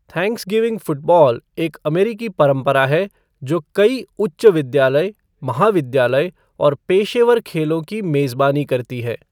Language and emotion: Hindi, neutral